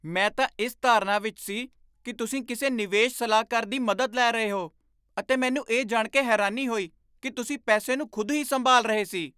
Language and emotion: Punjabi, surprised